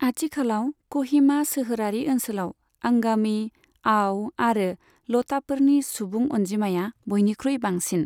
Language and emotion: Bodo, neutral